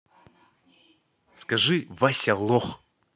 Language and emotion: Russian, angry